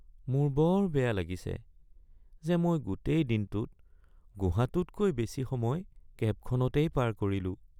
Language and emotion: Assamese, sad